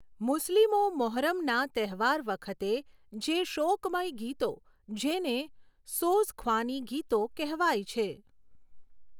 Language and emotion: Gujarati, neutral